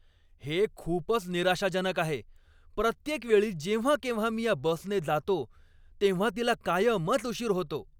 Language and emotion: Marathi, angry